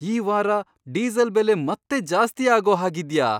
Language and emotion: Kannada, surprised